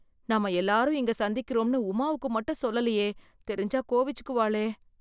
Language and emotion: Tamil, fearful